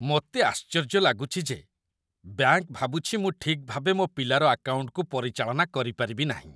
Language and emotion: Odia, disgusted